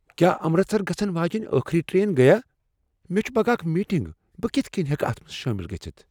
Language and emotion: Kashmiri, fearful